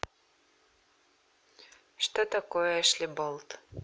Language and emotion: Russian, neutral